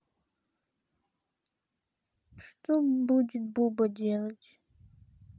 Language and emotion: Russian, sad